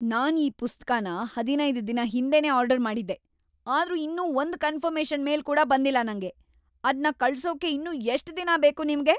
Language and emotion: Kannada, angry